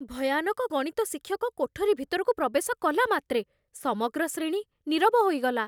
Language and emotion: Odia, fearful